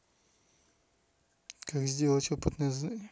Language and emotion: Russian, neutral